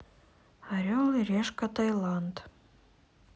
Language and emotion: Russian, sad